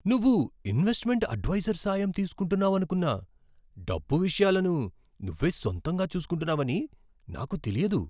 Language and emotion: Telugu, surprised